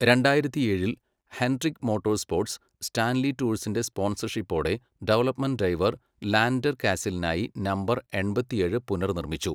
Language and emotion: Malayalam, neutral